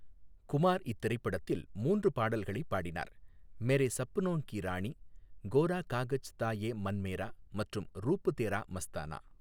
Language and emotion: Tamil, neutral